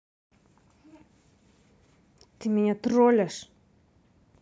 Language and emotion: Russian, angry